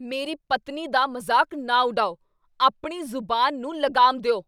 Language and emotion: Punjabi, angry